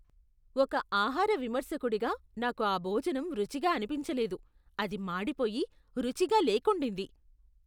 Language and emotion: Telugu, disgusted